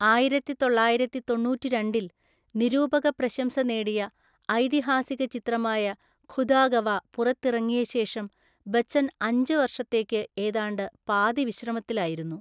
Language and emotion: Malayalam, neutral